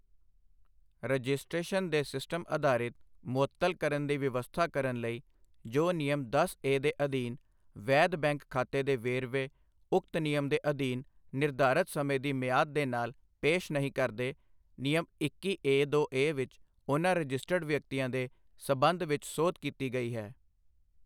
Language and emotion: Punjabi, neutral